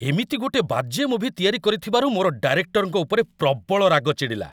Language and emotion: Odia, angry